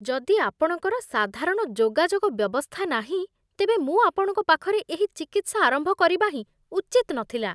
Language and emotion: Odia, disgusted